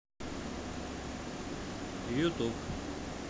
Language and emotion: Russian, neutral